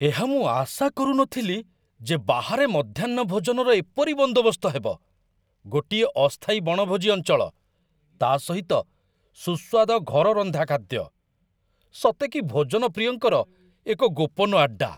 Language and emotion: Odia, surprised